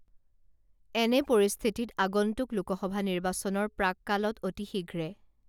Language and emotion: Assamese, neutral